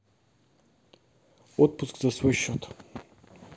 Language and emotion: Russian, neutral